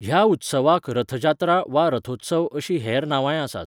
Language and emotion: Goan Konkani, neutral